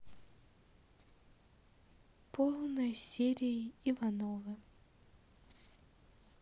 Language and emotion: Russian, sad